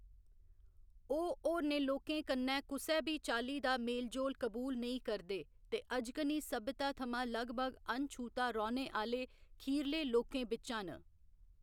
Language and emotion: Dogri, neutral